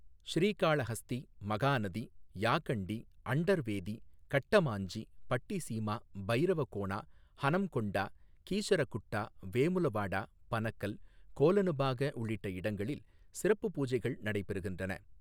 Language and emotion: Tamil, neutral